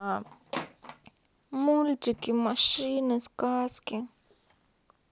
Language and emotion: Russian, sad